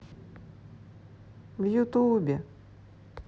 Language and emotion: Russian, sad